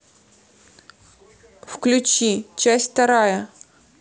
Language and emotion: Russian, neutral